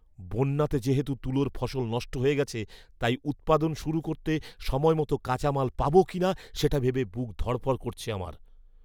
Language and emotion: Bengali, fearful